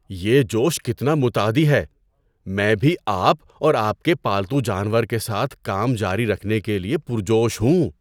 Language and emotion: Urdu, surprised